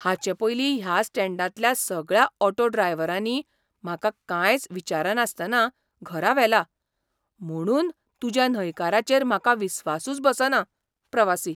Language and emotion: Goan Konkani, surprised